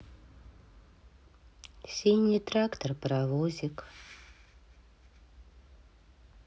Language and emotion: Russian, sad